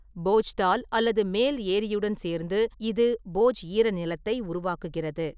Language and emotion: Tamil, neutral